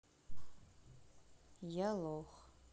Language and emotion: Russian, sad